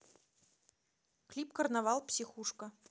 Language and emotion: Russian, neutral